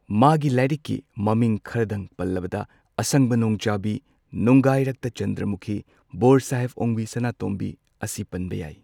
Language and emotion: Manipuri, neutral